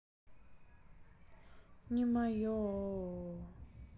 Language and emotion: Russian, sad